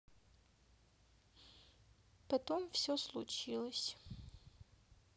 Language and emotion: Russian, sad